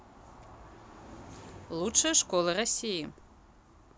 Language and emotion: Russian, neutral